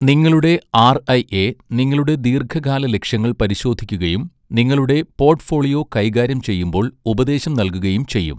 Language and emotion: Malayalam, neutral